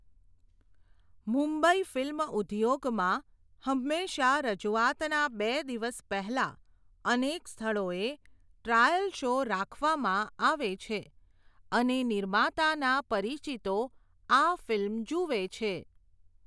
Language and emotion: Gujarati, neutral